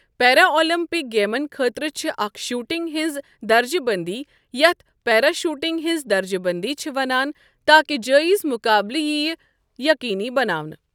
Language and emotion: Kashmiri, neutral